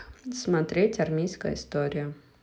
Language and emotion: Russian, neutral